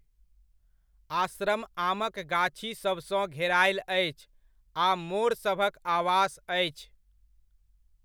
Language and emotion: Maithili, neutral